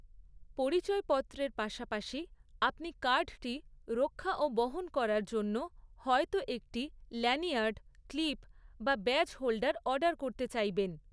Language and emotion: Bengali, neutral